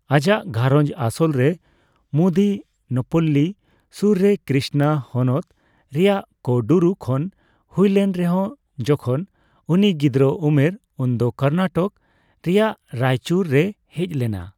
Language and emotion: Santali, neutral